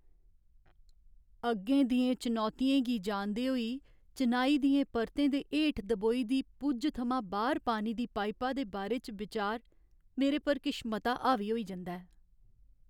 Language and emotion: Dogri, sad